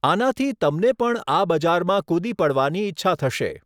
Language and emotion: Gujarati, neutral